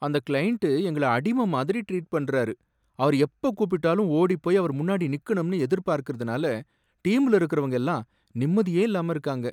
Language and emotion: Tamil, sad